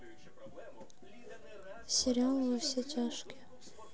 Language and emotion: Russian, sad